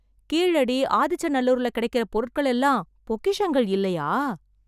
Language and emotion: Tamil, surprised